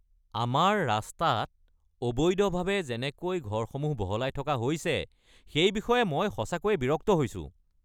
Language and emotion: Assamese, angry